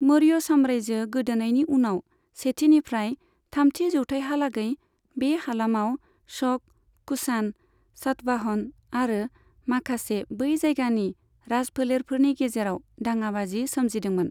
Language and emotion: Bodo, neutral